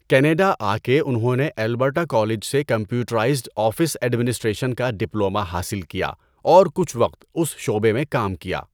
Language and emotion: Urdu, neutral